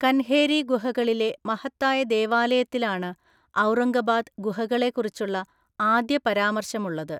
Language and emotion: Malayalam, neutral